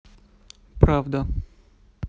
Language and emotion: Russian, neutral